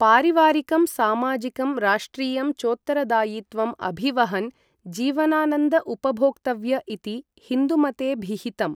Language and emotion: Sanskrit, neutral